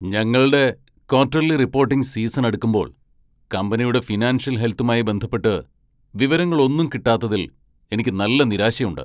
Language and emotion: Malayalam, angry